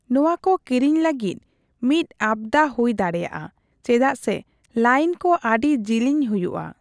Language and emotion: Santali, neutral